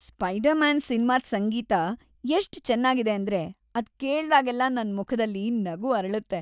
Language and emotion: Kannada, happy